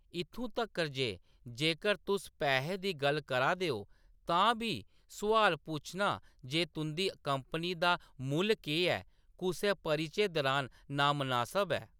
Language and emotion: Dogri, neutral